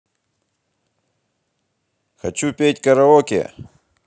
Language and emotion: Russian, positive